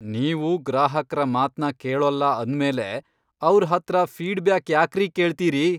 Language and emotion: Kannada, angry